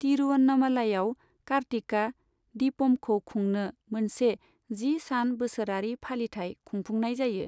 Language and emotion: Bodo, neutral